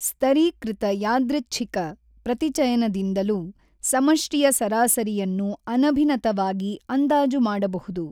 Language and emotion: Kannada, neutral